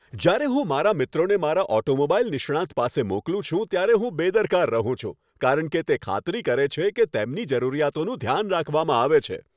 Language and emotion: Gujarati, happy